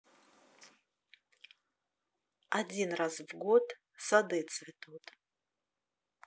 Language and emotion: Russian, neutral